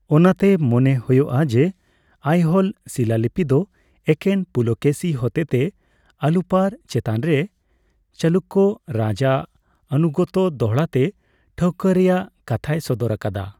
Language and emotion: Santali, neutral